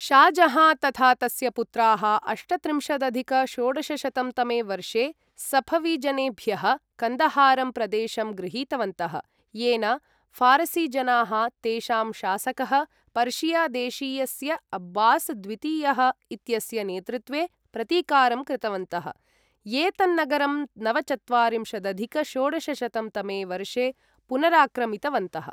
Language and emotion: Sanskrit, neutral